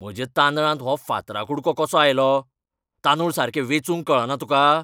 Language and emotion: Goan Konkani, angry